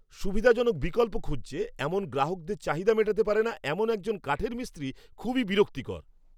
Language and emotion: Bengali, angry